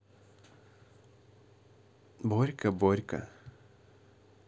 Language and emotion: Russian, neutral